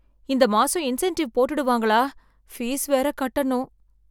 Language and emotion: Tamil, fearful